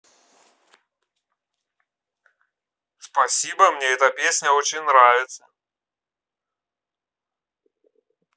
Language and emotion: Russian, positive